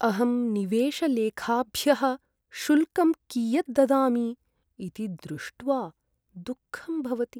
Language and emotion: Sanskrit, sad